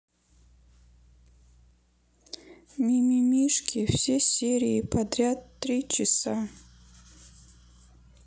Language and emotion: Russian, sad